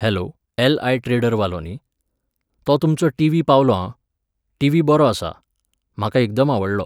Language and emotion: Goan Konkani, neutral